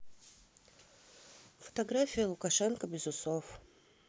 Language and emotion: Russian, neutral